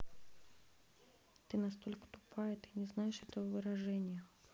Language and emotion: Russian, neutral